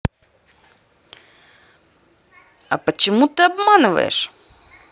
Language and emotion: Russian, angry